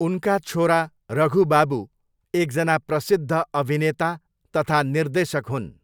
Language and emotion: Nepali, neutral